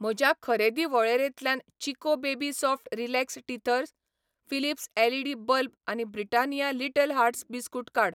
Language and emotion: Goan Konkani, neutral